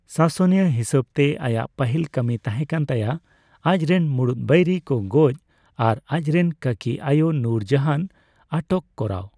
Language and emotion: Santali, neutral